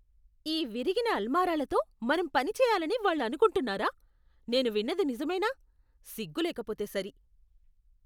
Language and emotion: Telugu, disgusted